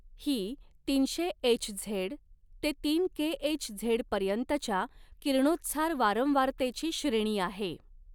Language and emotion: Marathi, neutral